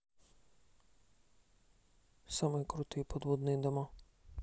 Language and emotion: Russian, neutral